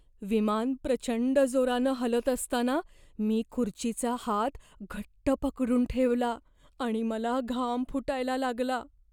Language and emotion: Marathi, fearful